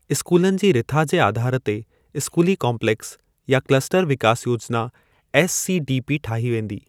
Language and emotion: Sindhi, neutral